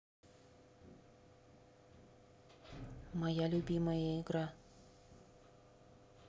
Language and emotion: Russian, neutral